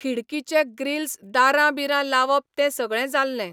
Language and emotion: Goan Konkani, neutral